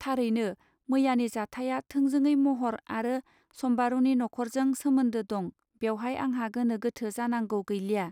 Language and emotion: Bodo, neutral